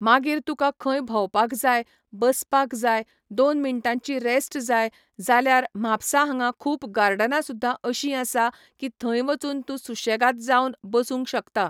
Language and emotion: Goan Konkani, neutral